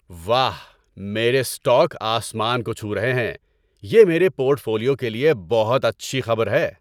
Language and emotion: Urdu, happy